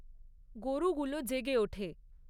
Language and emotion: Bengali, neutral